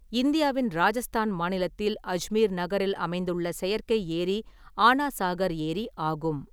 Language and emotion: Tamil, neutral